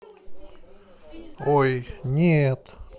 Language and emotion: Russian, neutral